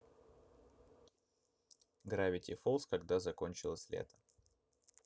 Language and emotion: Russian, neutral